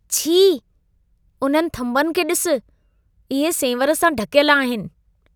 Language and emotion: Sindhi, disgusted